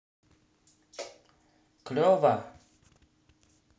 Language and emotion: Russian, positive